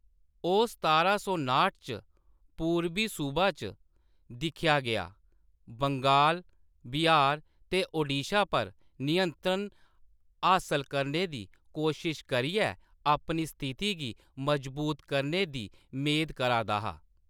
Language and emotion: Dogri, neutral